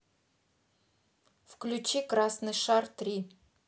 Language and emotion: Russian, neutral